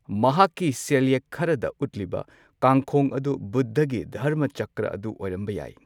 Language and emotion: Manipuri, neutral